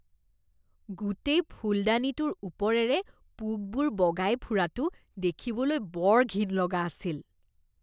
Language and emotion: Assamese, disgusted